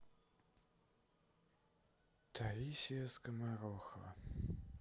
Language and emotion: Russian, sad